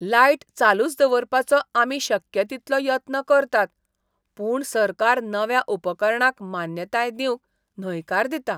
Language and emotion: Goan Konkani, disgusted